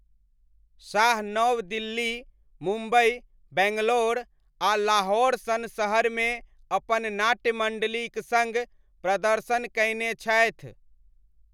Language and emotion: Maithili, neutral